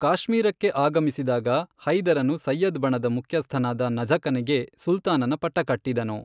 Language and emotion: Kannada, neutral